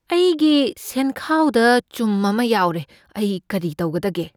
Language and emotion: Manipuri, fearful